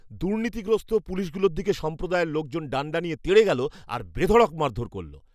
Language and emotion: Bengali, angry